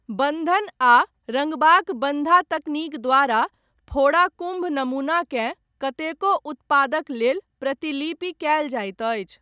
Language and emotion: Maithili, neutral